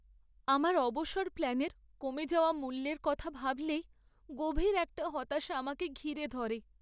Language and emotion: Bengali, sad